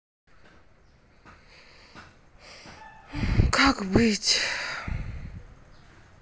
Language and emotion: Russian, sad